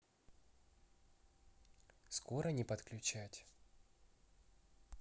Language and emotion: Russian, neutral